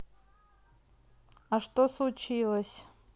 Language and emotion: Russian, neutral